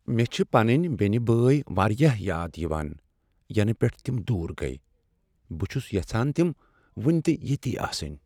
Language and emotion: Kashmiri, sad